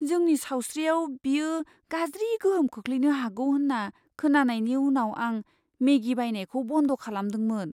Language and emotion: Bodo, fearful